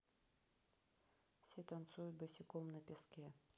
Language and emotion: Russian, neutral